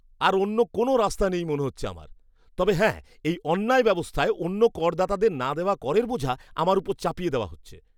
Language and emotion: Bengali, disgusted